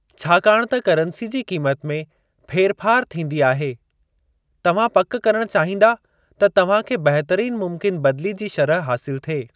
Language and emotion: Sindhi, neutral